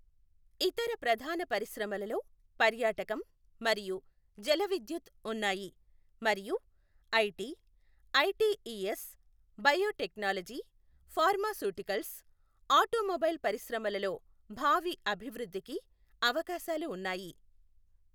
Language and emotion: Telugu, neutral